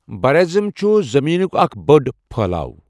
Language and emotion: Kashmiri, neutral